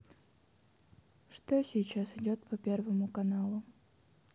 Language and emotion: Russian, sad